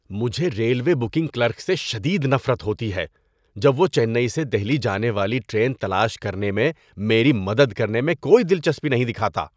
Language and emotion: Urdu, disgusted